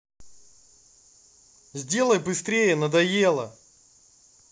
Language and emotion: Russian, angry